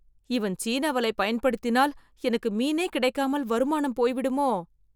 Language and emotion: Tamil, fearful